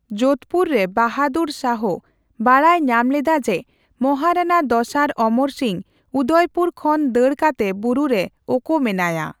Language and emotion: Santali, neutral